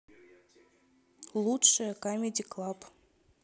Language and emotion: Russian, neutral